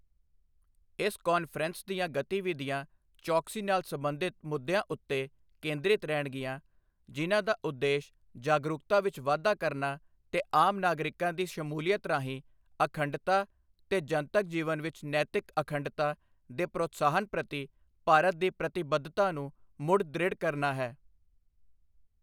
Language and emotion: Punjabi, neutral